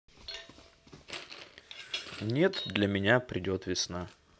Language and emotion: Russian, neutral